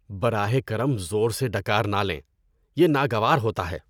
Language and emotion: Urdu, disgusted